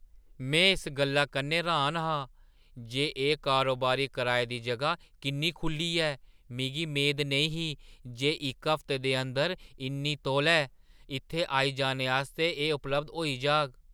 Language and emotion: Dogri, surprised